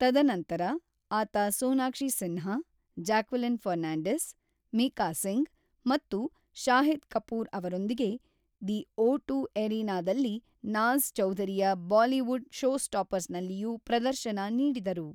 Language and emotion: Kannada, neutral